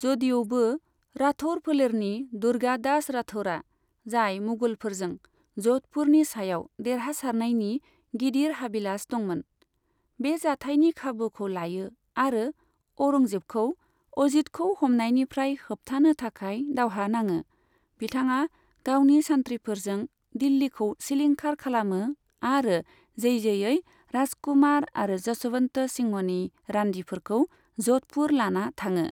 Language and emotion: Bodo, neutral